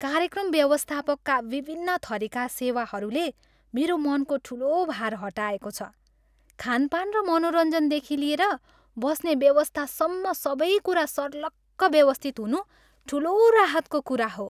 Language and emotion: Nepali, happy